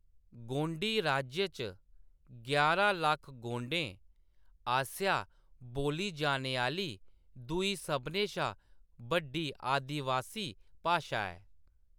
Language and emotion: Dogri, neutral